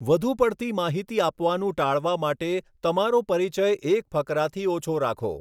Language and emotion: Gujarati, neutral